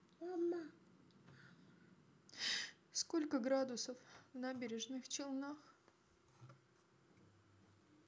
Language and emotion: Russian, sad